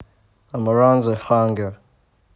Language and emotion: Russian, neutral